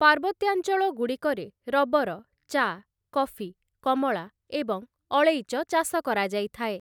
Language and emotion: Odia, neutral